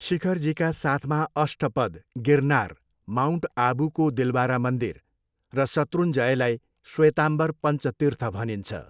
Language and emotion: Nepali, neutral